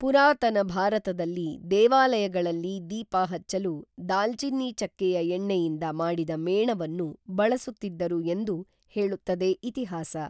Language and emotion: Kannada, neutral